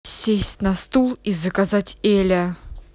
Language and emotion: Russian, angry